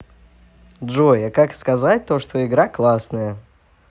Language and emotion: Russian, positive